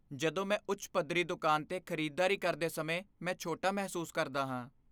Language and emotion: Punjabi, fearful